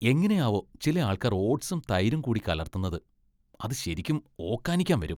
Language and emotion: Malayalam, disgusted